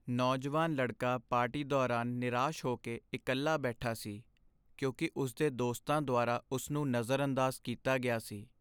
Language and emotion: Punjabi, sad